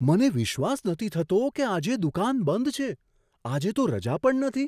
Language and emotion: Gujarati, surprised